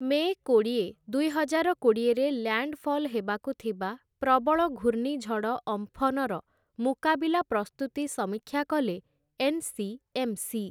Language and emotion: Odia, neutral